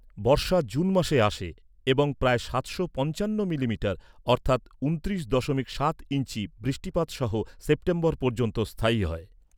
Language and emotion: Bengali, neutral